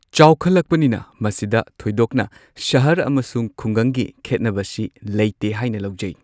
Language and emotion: Manipuri, neutral